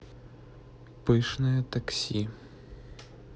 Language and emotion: Russian, neutral